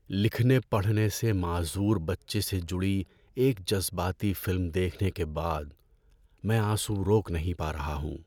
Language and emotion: Urdu, sad